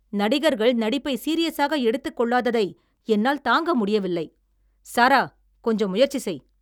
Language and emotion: Tamil, angry